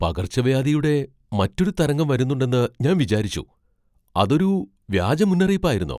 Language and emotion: Malayalam, surprised